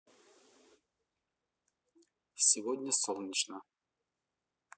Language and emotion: Russian, neutral